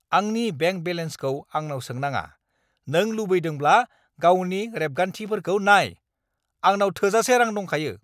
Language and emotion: Bodo, angry